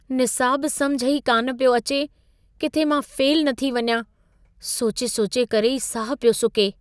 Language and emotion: Sindhi, fearful